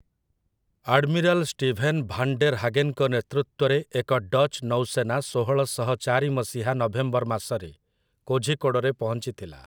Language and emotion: Odia, neutral